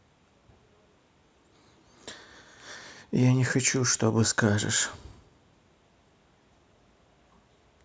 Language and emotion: Russian, sad